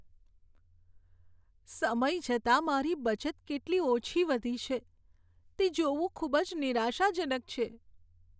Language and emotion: Gujarati, sad